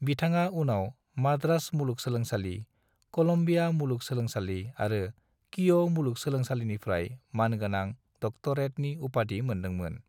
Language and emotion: Bodo, neutral